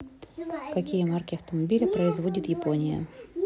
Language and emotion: Russian, neutral